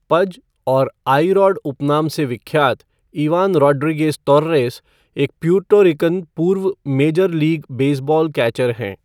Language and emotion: Hindi, neutral